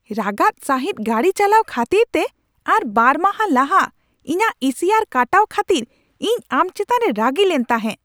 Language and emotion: Santali, angry